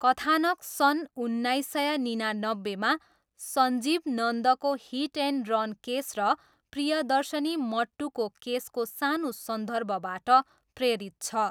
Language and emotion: Nepali, neutral